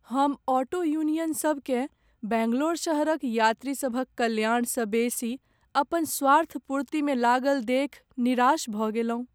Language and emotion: Maithili, sad